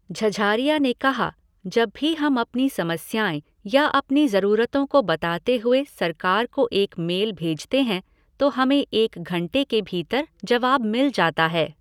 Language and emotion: Hindi, neutral